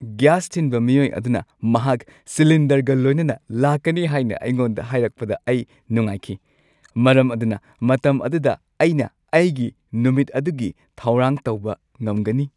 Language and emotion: Manipuri, happy